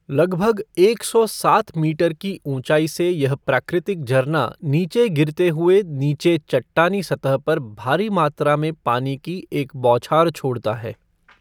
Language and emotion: Hindi, neutral